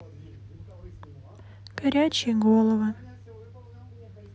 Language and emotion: Russian, sad